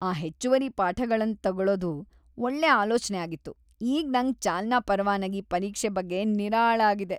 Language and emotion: Kannada, happy